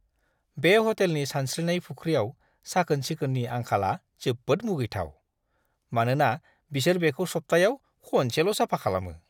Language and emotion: Bodo, disgusted